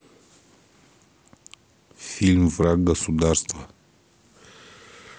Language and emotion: Russian, neutral